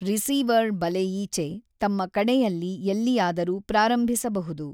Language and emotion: Kannada, neutral